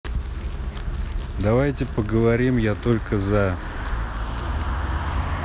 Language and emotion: Russian, neutral